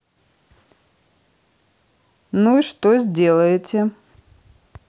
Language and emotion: Russian, neutral